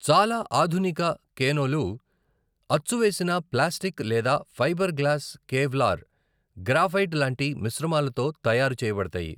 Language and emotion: Telugu, neutral